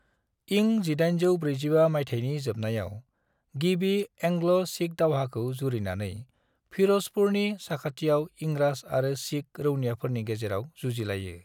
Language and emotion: Bodo, neutral